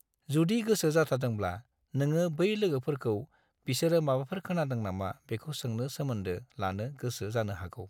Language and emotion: Bodo, neutral